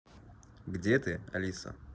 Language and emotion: Russian, neutral